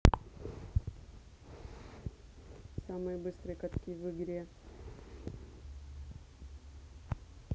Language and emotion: Russian, neutral